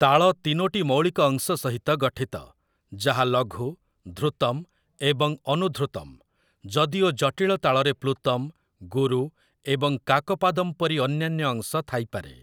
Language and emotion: Odia, neutral